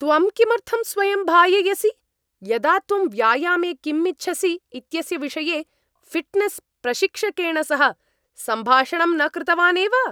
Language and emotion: Sanskrit, angry